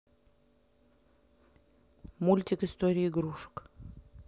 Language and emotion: Russian, neutral